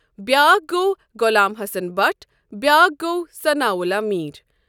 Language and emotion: Kashmiri, neutral